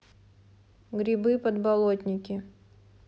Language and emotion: Russian, neutral